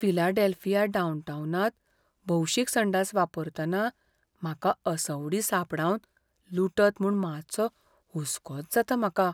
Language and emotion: Goan Konkani, fearful